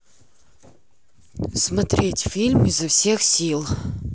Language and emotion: Russian, neutral